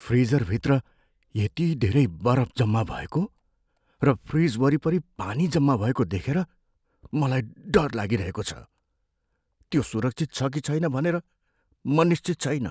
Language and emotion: Nepali, fearful